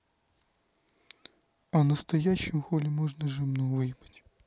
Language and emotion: Russian, neutral